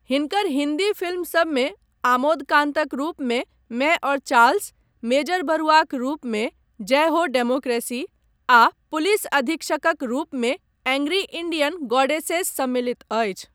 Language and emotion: Maithili, neutral